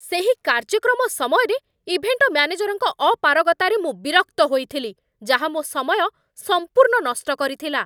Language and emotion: Odia, angry